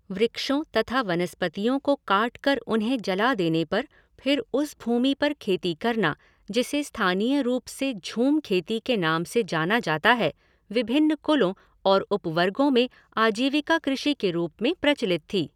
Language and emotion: Hindi, neutral